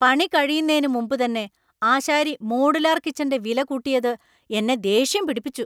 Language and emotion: Malayalam, angry